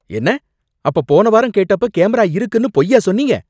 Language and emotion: Tamil, angry